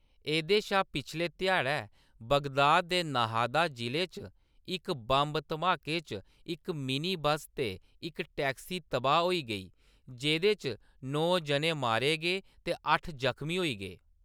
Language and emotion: Dogri, neutral